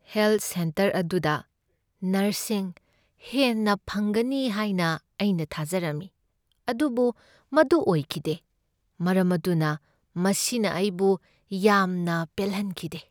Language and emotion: Manipuri, sad